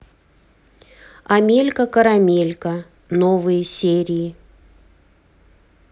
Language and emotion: Russian, neutral